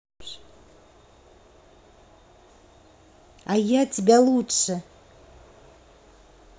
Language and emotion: Russian, positive